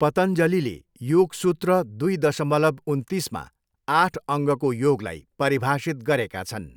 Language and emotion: Nepali, neutral